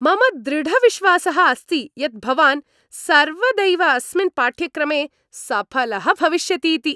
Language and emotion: Sanskrit, happy